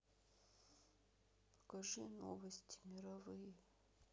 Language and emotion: Russian, sad